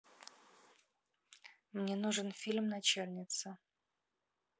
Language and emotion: Russian, neutral